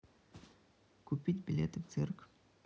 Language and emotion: Russian, neutral